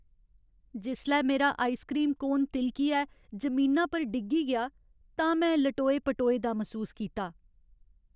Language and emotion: Dogri, sad